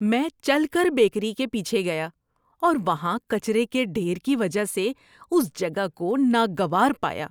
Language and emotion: Urdu, disgusted